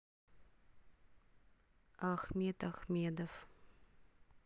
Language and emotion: Russian, neutral